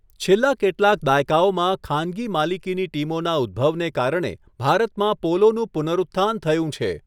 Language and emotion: Gujarati, neutral